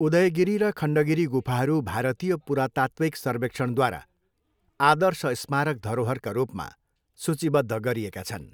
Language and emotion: Nepali, neutral